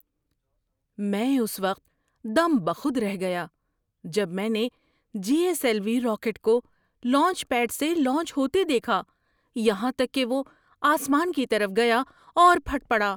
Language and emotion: Urdu, surprised